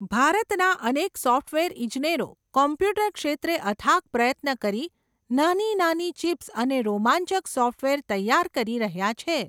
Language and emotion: Gujarati, neutral